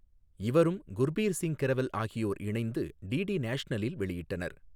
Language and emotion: Tamil, neutral